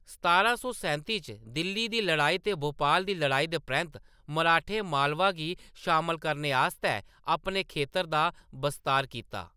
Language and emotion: Dogri, neutral